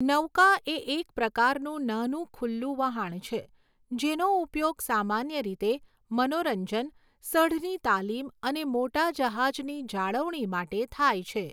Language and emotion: Gujarati, neutral